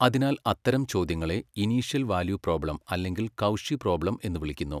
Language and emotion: Malayalam, neutral